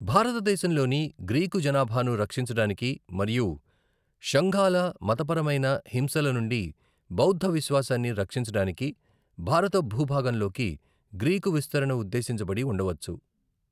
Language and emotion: Telugu, neutral